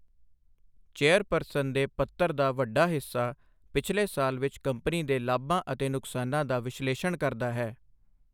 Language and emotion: Punjabi, neutral